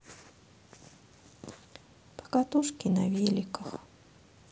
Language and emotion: Russian, sad